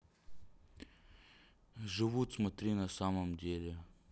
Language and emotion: Russian, neutral